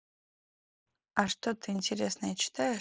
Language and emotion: Russian, neutral